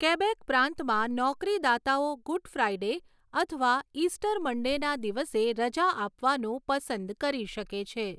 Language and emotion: Gujarati, neutral